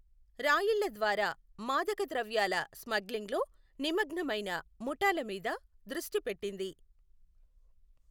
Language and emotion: Telugu, neutral